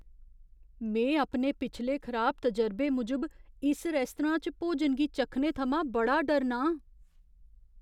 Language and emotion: Dogri, fearful